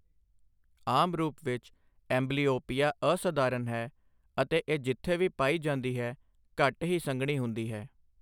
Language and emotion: Punjabi, neutral